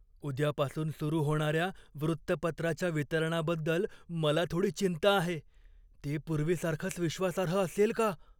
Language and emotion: Marathi, fearful